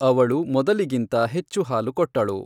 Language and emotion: Kannada, neutral